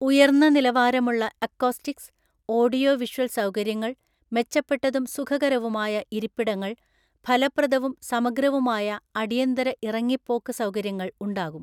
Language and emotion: Malayalam, neutral